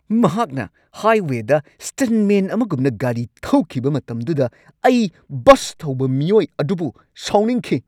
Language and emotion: Manipuri, angry